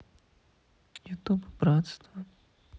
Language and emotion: Russian, sad